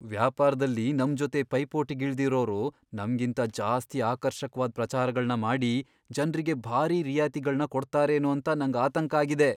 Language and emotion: Kannada, fearful